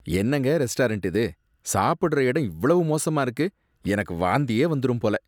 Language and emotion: Tamil, disgusted